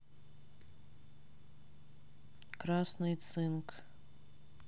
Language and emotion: Russian, neutral